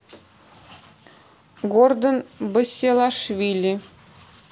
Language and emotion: Russian, neutral